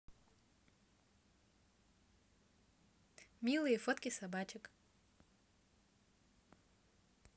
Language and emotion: Russian, positive